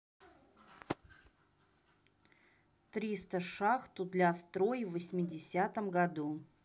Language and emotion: Russian, neutral